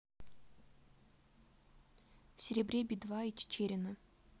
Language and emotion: Russian, neutral